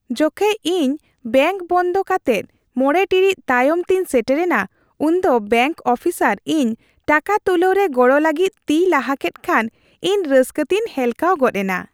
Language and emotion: Santali, happy